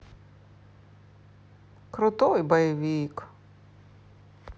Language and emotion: Russian, positive